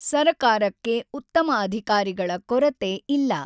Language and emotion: Kannada, neutral